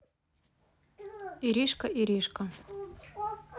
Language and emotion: Russian, neutral